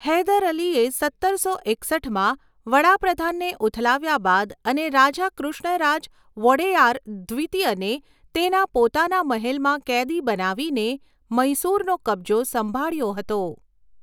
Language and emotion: Gujarati, neutral